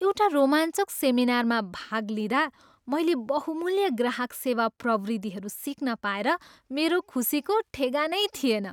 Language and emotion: Nepali, happy